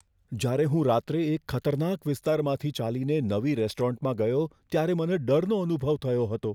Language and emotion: Gujarati, fearful